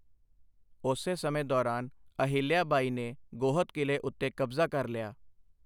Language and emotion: Punjabi, neutral